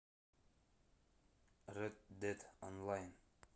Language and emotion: Russian, neutral